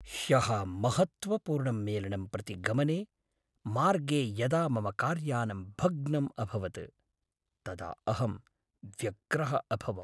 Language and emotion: Sanskrit, sad